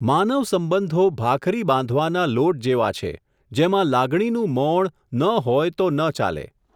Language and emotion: Gujarati, neutral